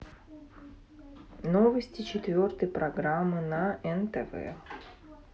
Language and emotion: Russian, neutral